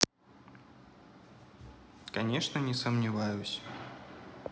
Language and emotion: Russian, neutral